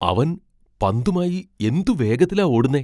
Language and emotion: Malayalam, surprised